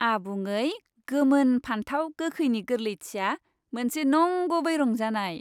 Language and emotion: Bodo, happy